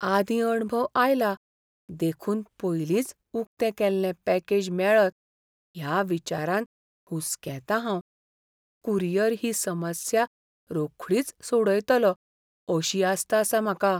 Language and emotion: Goan Konkani, fearful